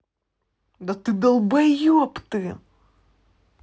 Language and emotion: Russian, angry